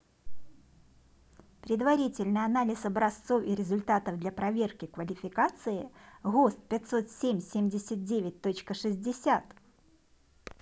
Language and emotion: Russian, neutral